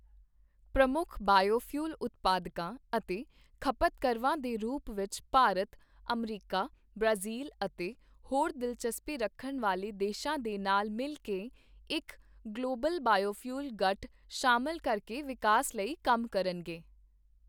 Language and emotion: Punjabi, neutral